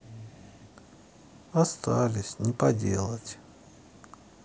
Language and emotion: Russian, sad